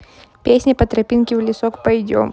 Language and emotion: Russian, neutral